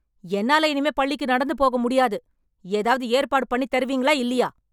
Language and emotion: Tamil, angry